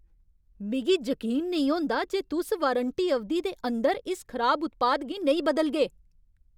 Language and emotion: Dogri, angry